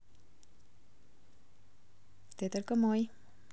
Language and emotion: Russian, neutral